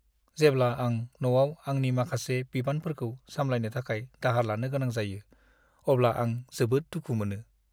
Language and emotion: Bodo, sad